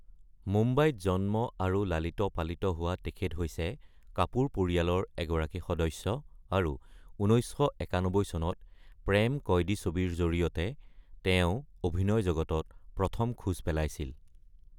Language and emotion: Assamese, neutral